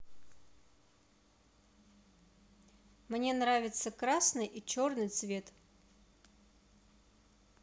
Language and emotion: Russian, neutral